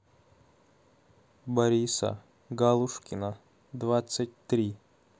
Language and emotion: Russian, neutral